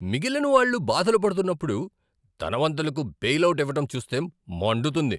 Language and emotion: Telugu, angry